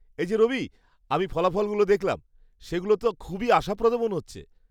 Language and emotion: Bengali, happy